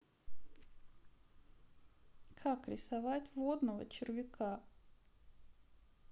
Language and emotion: Russian, sad